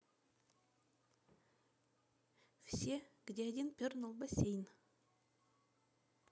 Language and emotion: Russian, neutral